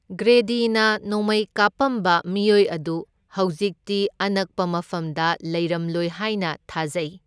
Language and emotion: Manipuri, neutral